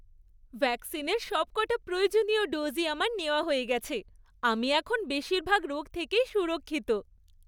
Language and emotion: Bengali, happy